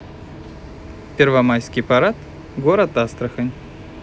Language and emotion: Russian, neutral